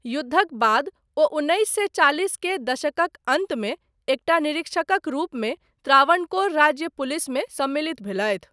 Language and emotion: Maithili, neutral